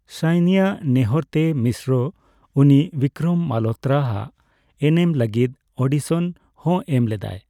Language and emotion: Santali, neutral